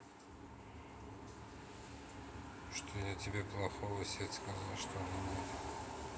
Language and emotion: Russian, neutral